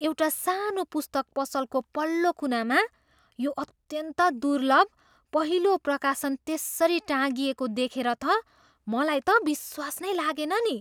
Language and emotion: Nepali, surprised